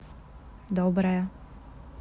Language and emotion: Russian, positive